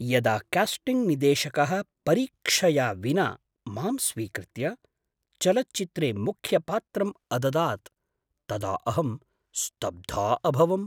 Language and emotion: Sanskrit, surprised